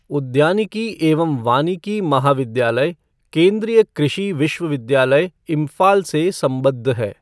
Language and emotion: Hindi, neutral